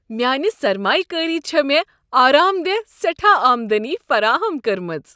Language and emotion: Kashmiri, happy